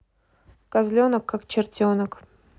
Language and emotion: Russian, neutral